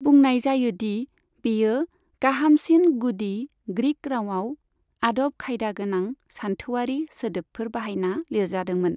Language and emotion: Bodo, neutral